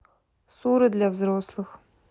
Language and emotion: Russian, neutral